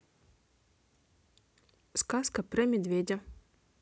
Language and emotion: Russian, neutral